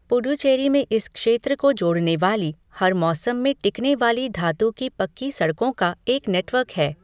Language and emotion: Hindi, neutral